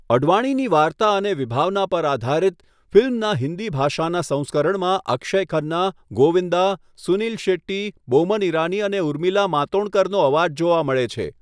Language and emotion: Gujarati, neutral